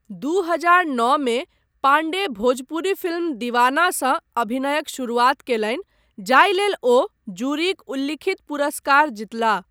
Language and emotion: Maithili, neutral